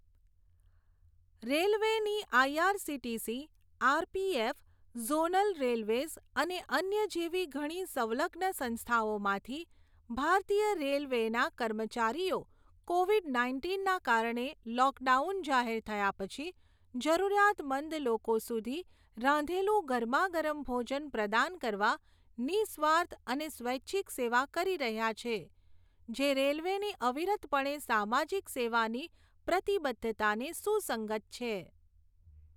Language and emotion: Gujarati, neutral